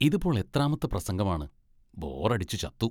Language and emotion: Malayalam, disgusted